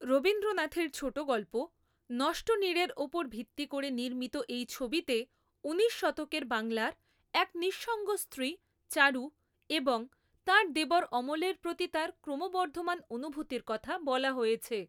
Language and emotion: Bengali, neutral